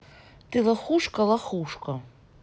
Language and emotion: Russian, angry